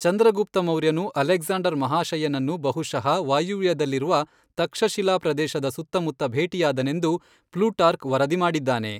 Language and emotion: Kannada, neutral